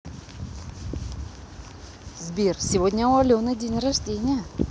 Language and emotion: Russian, positive